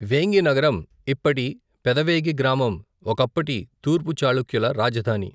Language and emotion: Telugu, neutral